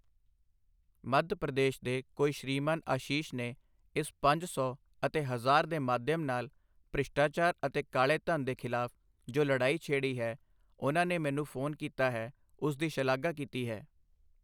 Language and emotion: Punjabi, neutral